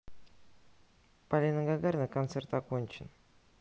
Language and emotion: Russian, neutral